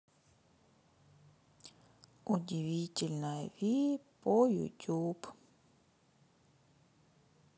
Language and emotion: Russian, sad